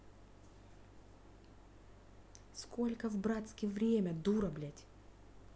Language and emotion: Russian, angry